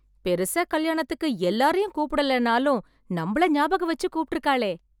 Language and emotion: Tamil, happy